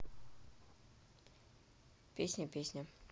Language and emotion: Russian, neutral